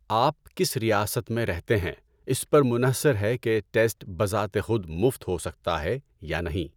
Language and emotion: Urdu, neutral